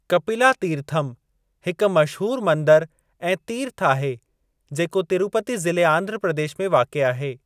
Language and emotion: Sindhi, neutral